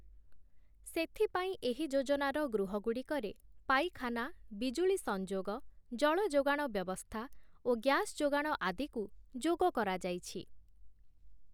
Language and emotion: Odia, neutral